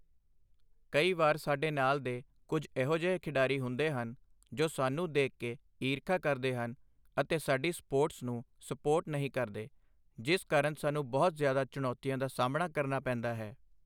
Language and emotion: Punjabi, neutral